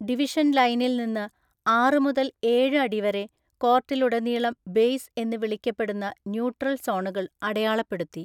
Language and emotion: Malayalam, neutral